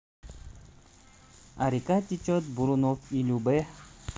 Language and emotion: Russian, neutral